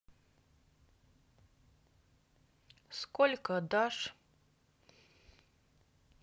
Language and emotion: Russian, neutral